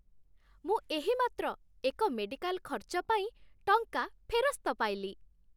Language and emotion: Odia, happy